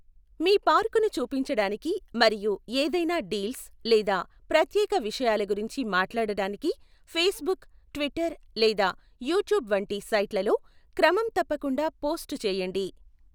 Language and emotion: Telugu, neutral